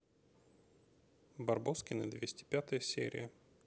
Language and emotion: Russian, neutral